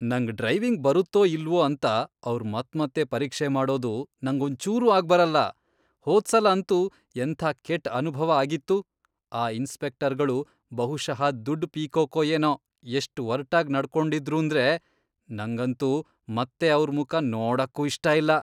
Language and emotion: Kannada, disgusted